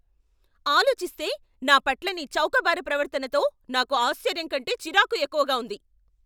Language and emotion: Telugu, angry